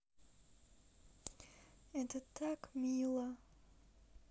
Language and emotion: Russian, sad